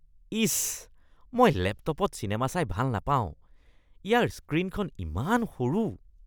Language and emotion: Assamese, disgusted